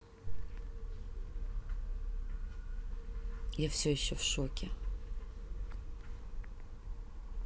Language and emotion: Russian, neutral